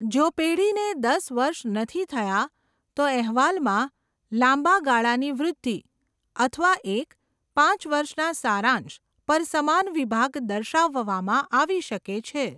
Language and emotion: Gujarati, neutral